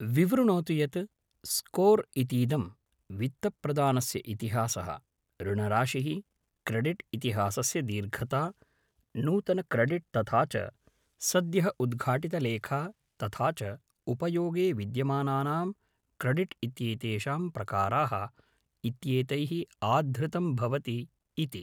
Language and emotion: Sanskrit, neutral